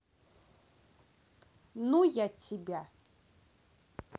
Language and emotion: Russian, angry